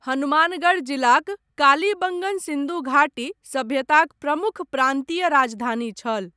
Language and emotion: Maithili, neutral